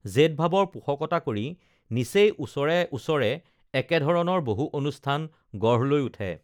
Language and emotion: Assamese, neutral